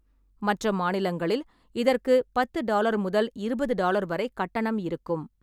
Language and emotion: Tamil, neutral